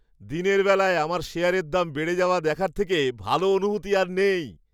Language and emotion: Bengali, happy